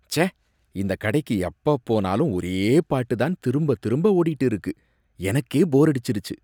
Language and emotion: Tamil, disgusted